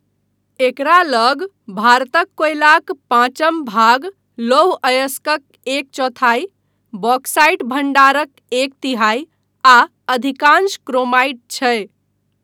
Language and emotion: Maithili, neutral